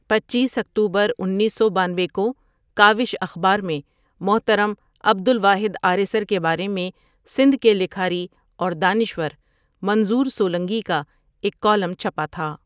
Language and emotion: Urdu, neutral